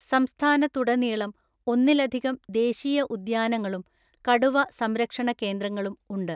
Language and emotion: Malayalam, neutral